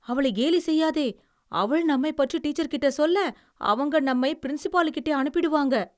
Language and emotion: Tamil, fearful